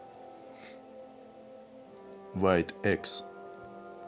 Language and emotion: Russian, neutral